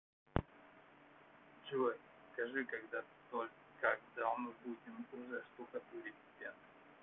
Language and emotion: Russian, neutral